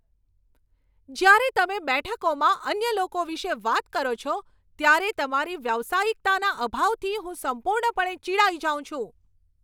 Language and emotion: Gujarati, angry